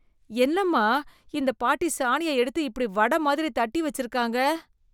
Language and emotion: Tamil, disgusted